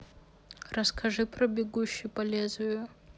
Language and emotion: Russian, neutral